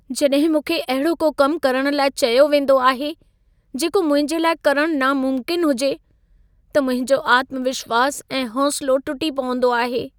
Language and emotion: Sindhi, sad